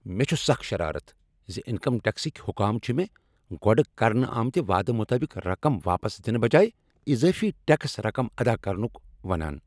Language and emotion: Kashmiri, angry